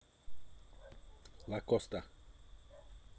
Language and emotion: Russian, neutral